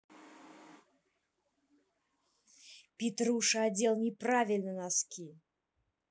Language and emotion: Russian, angry